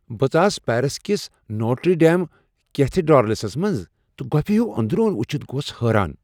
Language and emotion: Kashmiri, surprised